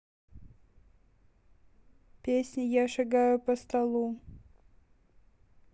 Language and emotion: Russian, neutral